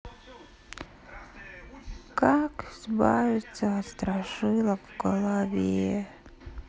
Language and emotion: Russian, sad